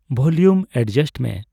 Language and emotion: Santali, neutral